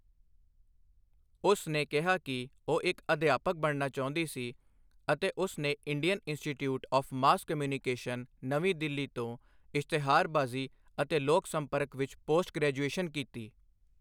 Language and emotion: Punjabi, neutral